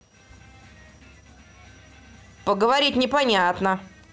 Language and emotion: Russian, neutral